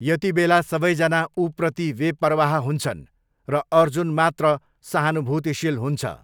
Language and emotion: Nepali, neutral